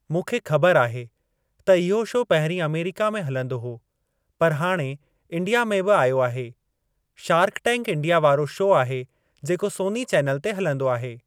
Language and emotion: Sindhi, neutral